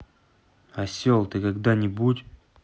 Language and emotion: Russian, angry